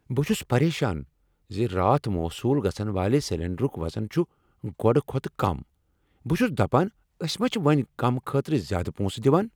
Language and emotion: Kashmiri, angry